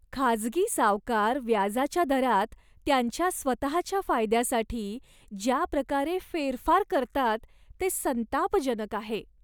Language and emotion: Marathi, disgusted